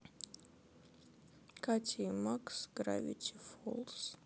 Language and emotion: Russian, sad